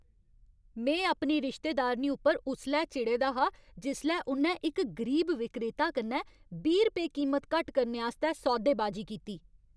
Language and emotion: Dogri, angry